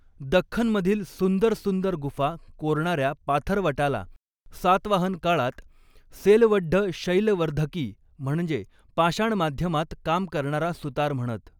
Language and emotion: Marathi, neutral